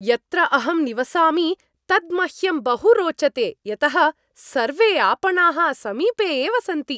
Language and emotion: Sanskrit, happy